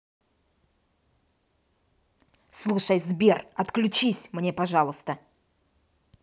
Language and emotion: Russian, angry